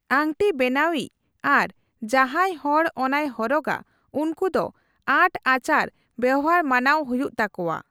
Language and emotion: Santali, neutral